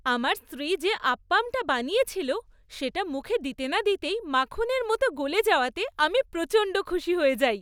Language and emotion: Bengali, happy